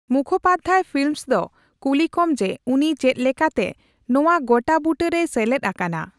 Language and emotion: Santali, neutral